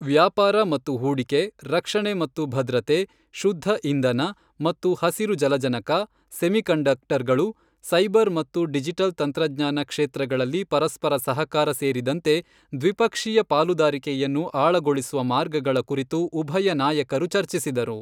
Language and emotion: Kannada, neutral